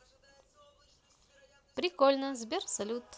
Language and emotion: Russian, positive